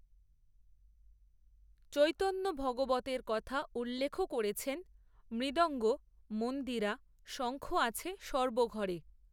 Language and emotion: Bengali, neutral